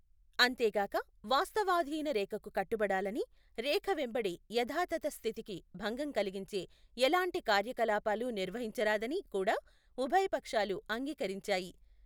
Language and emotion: Telugu, neutral